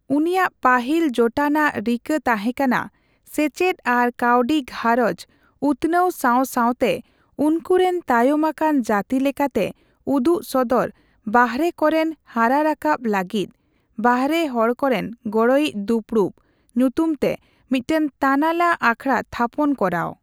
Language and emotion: Santali, neutral